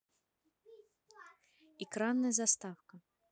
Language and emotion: Russian, neutral